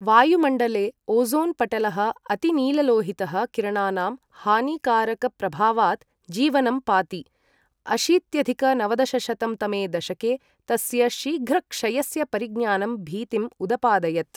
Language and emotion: Sanskrit, neutral